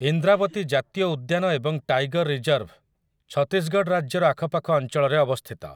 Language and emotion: Odia, neutral